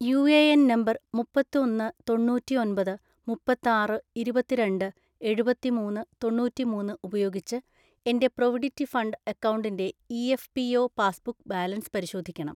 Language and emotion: Malayalam, neutral